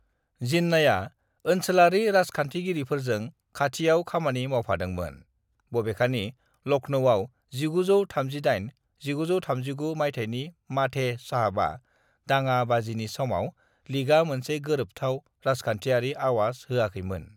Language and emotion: Bodo, neutral